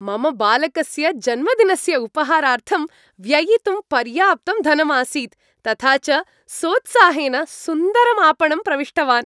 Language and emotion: Sanskrit, happy